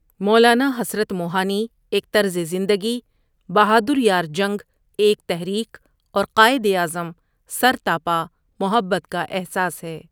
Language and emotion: Urdu, neutral